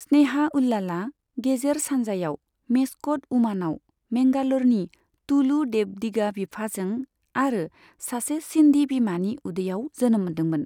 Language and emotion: Bodo, neutral